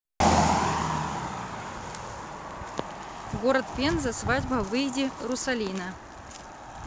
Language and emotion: Russian, neutral